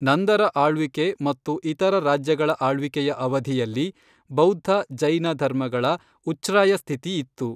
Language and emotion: Kannada, neutral